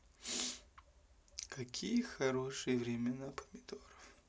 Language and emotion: Russian, sad